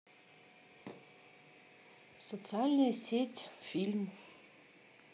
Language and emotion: Russian, neutral